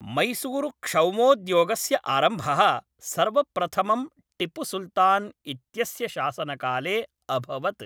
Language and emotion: Sanskrit, neutral